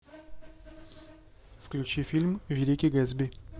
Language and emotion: Russian, neutral